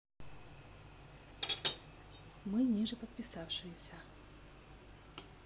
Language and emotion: Russian, neutral